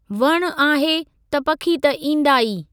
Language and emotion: Sindhi, neutral